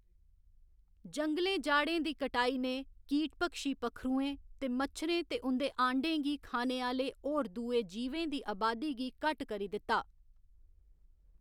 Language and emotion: Dogri, neutral